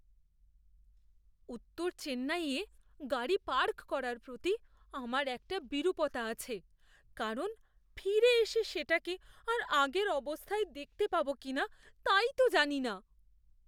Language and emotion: Bengali, fearful